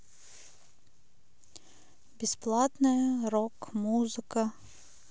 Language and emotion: Russian, neutral